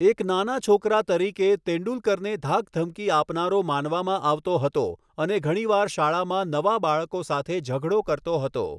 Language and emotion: Gujarati, neutral